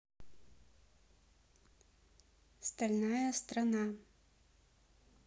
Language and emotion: Russian, neutral